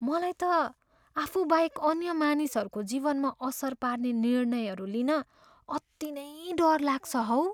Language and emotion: Nepali, fearful